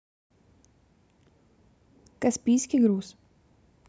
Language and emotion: Russian, neutral